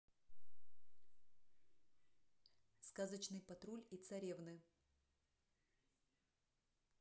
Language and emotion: Russian, neutral